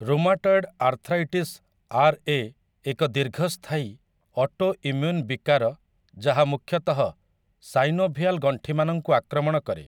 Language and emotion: Odia, neutral